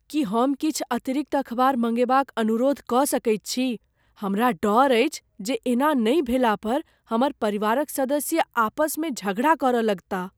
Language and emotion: Maithili, fearful